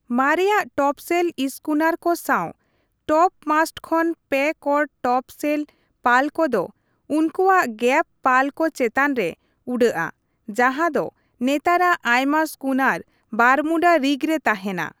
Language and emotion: Santali, neutral